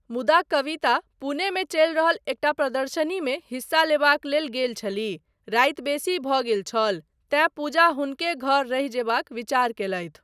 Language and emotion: Maithili, neutral